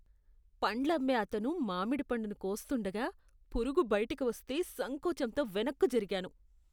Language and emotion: Telugu, disgusted